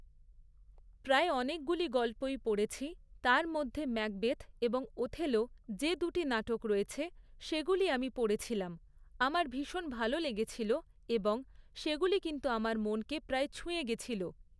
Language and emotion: Bengali, neutral